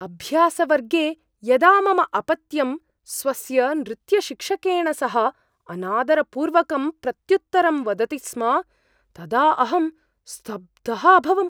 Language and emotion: Sanskrit, surprised